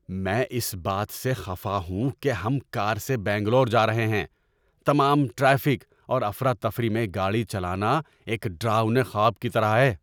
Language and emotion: Urdu, angry